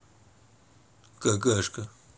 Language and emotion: Russian, neutral